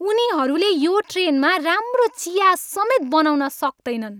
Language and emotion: Nepali, angry